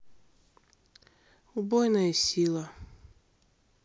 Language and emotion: Russian, sad